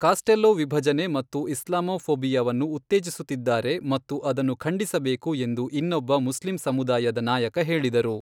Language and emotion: Kannada, neutral